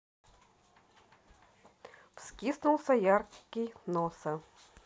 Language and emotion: Russian, neutral